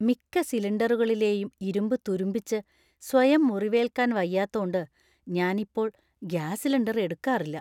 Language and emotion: Malayalam, fearful